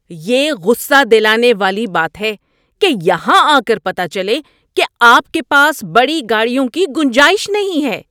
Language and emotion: Urdu, angry